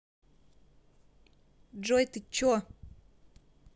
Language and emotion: Russian, angry